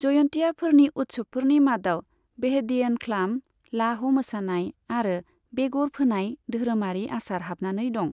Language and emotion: Bodo, neutral